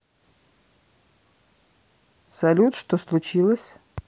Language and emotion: Russian, neutral